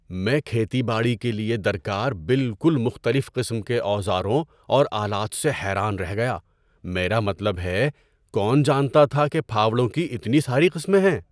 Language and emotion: Urdu, surprised